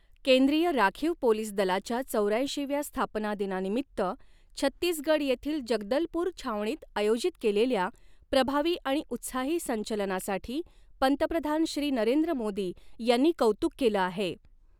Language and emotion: Marathi, neutral